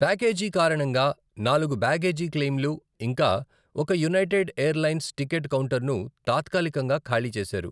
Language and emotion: Telugu, neutral